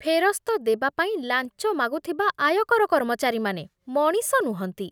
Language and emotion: Odia, disgusted